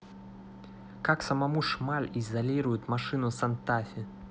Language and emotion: Russian, neutral